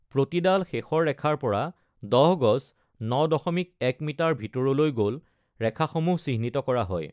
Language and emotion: Assamese, neutral